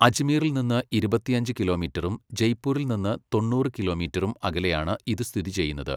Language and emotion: Malayalam, neutral